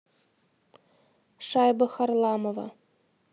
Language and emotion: Russian, neutral